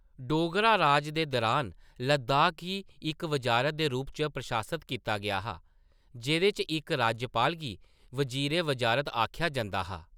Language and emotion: Dogri, neutral